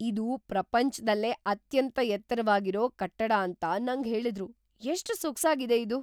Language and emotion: Kannada, surprised